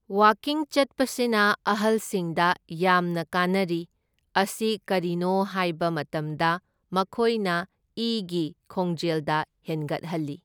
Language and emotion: Manipuri, neutral